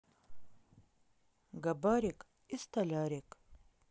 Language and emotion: Russian, neutral